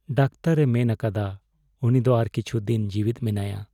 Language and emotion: Santali, sad